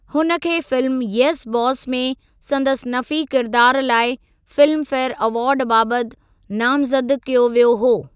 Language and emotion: Sindhi, neutral